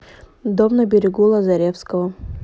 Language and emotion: Russian, neutral